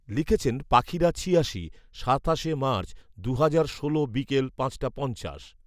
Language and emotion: Bengali, neutral